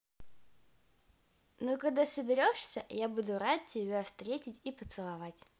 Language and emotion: Russian, positive